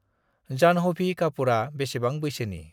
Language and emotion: Bodo, neutral